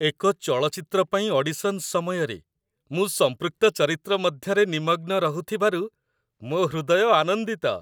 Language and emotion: Odia, happy